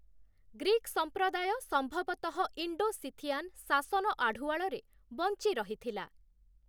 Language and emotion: Odia, neutral